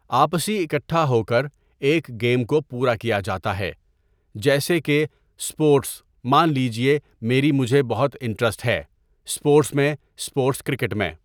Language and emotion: Urdu, neutral